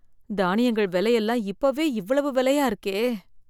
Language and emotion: Tamil, fearful